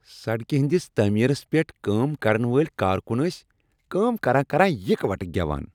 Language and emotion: Kashmiri, happy